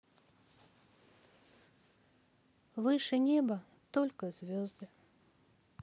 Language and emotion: Russian, sad